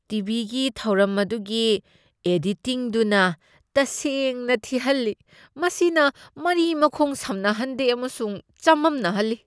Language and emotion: Manipuri, disgusted